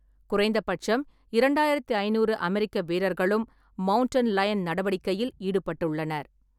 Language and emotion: Tamil, neutral